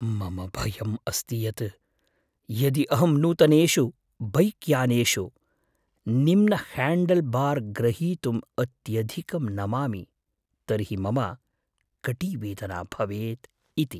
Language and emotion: Sanskrit, fearful